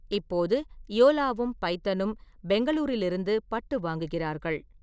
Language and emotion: Tamil, neutral